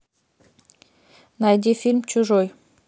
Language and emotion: Russian, neutral